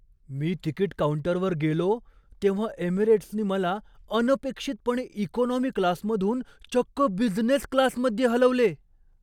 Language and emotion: Marathi, surprised